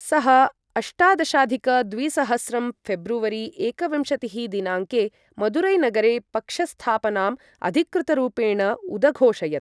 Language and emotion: Sanskrit, neutral